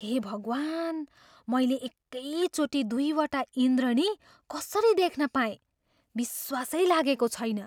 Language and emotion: Nepali, surprised